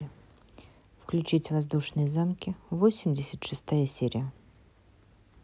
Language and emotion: Russian, neutral